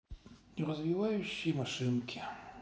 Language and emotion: Russian, sad